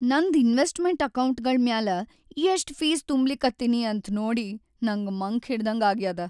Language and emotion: Kannada, sad